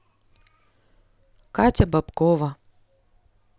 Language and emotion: Russian, neutral